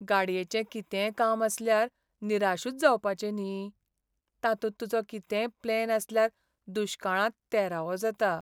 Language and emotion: Goan Konkani, sad